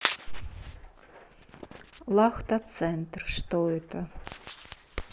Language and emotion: Russian, neutral